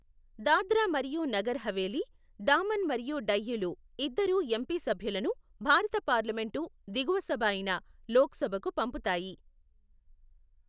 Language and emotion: Telugu, neutral